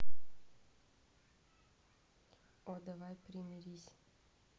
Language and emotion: Russian, neutral